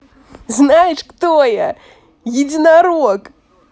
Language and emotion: Russian, positive